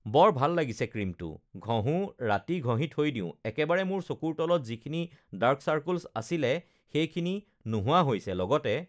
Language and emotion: Assamese, neutral